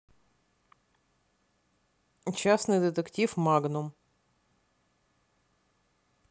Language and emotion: Russian, neutral